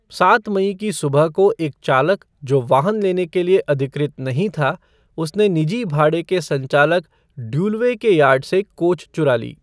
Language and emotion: Hindi, neutral